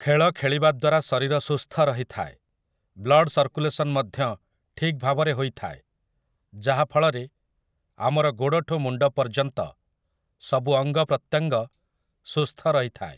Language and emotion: Odia, neutral